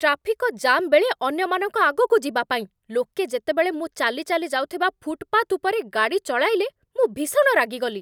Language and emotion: Odia, angry